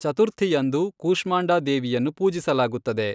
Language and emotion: Kannada, neutral